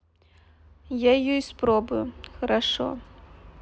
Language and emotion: Russian, sad